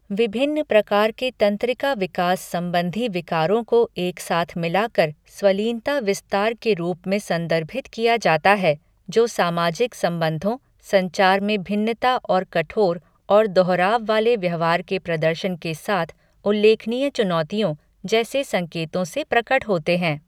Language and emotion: Hindi, neutral